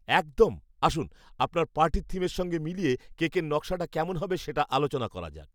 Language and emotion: Bengali, happy